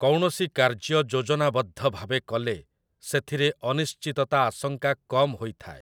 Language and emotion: Odia, neutral